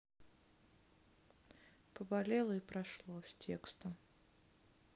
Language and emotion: Russian, neutral